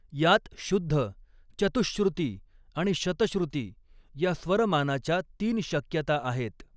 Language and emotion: Marathi, neutral